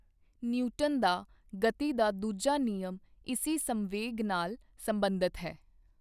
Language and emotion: Punjabi, neutral